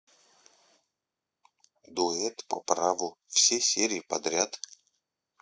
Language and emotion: Russian, neutral